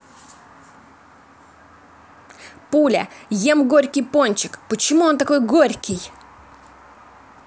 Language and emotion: Russian, angry